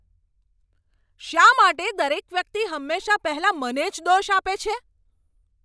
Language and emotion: Gujarati, angry